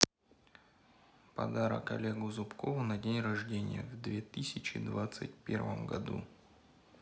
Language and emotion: Russian, neutral